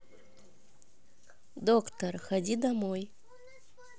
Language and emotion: Russian, neutral